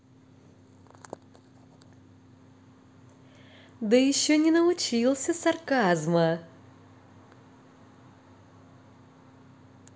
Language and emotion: Russian, positive